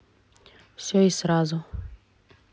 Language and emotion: Russian, neutral